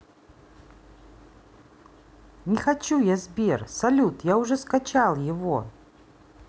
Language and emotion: Russian, neutral